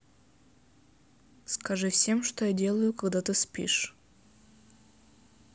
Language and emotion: Russian, neutral